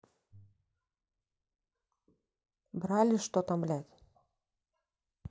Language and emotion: Russian, neutral